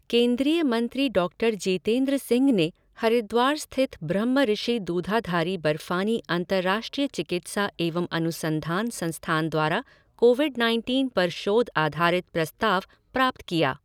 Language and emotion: Hindi, neutral